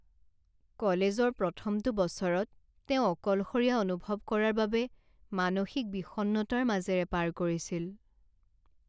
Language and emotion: Assamese, sad